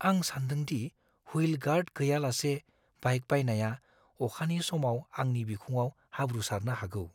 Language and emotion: Bodo, fearful